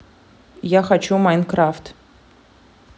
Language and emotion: Russian, neutral